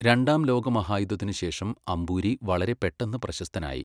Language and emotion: Malayalam, neutral